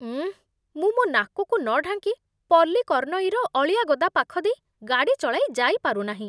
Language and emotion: Odia, disgusted